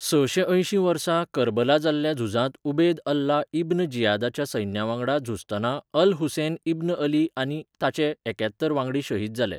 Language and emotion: Goan Konkani, neutral